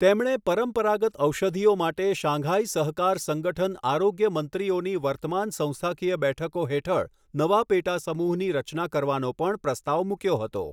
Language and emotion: Gujarati, neutral